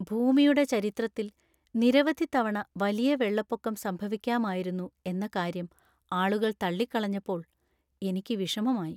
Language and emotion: Malayalam, sad